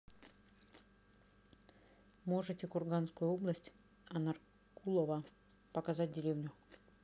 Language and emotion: Russian, neutral